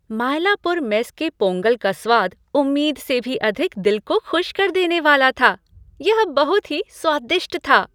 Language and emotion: Hindi, happy